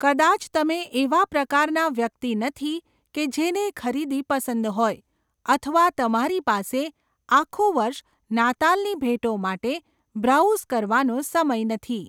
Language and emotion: Gujarati, neutral